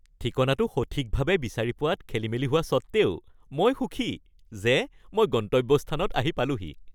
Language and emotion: Assamese, happy